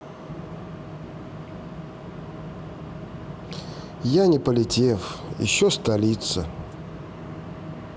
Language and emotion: Russian, sad